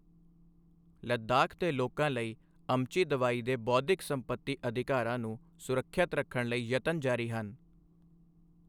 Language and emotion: Punjabi, neutral